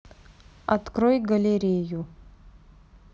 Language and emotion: Russian, neutral